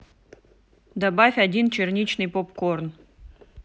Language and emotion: Russian, neutral